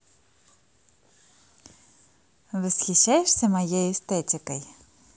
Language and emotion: Russian, positive